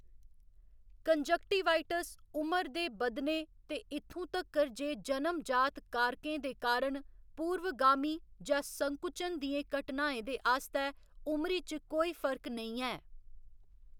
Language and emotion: Dogri, neutral